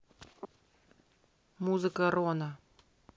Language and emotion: Russian, neutral